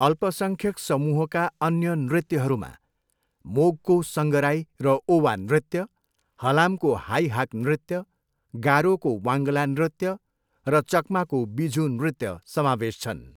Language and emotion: Nepali, neutral